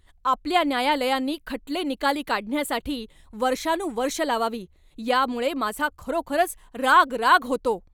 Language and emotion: Marathi, angry